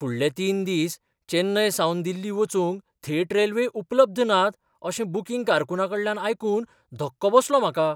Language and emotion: Goan Konkani, surprised